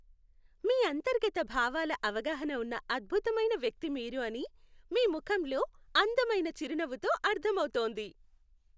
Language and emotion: Telugu, happy